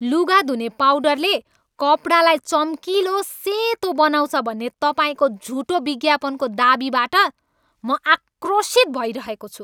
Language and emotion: Nepali, angry